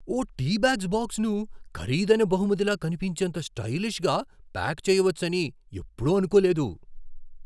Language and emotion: Telugu, surprised